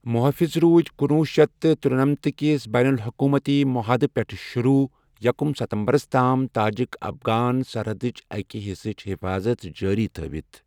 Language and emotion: Kashmiri, neutral